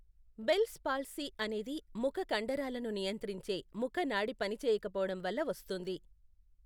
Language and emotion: Telugu, neutral